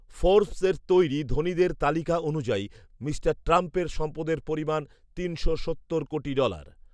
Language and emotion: Bengali, neutral